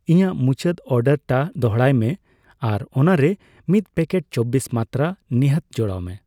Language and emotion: Santali, neutral